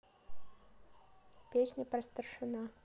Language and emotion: Russian, neutral